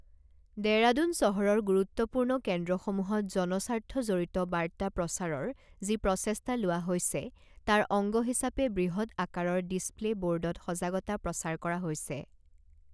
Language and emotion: Assamese, neutral